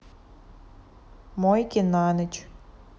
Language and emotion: Russian, neutral